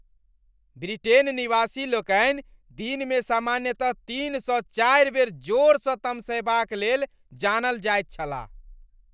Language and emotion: Maithili, angry